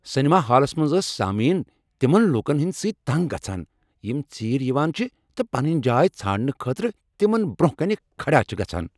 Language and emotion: Kashmiri, angry